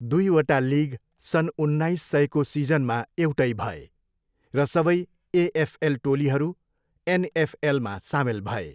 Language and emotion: Nepali, neutral